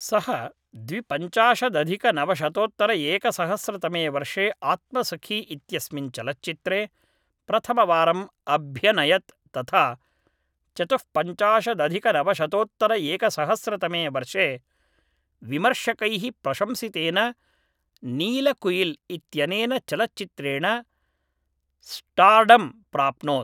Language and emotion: Sanskrit, neutral